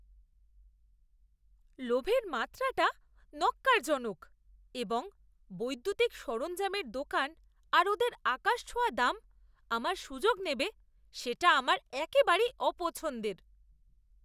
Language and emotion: Bengali, disgusted